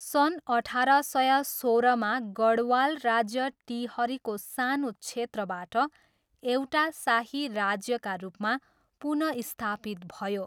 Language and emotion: Nepali, neutral